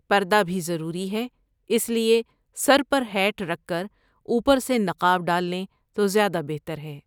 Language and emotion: Urdu, neutral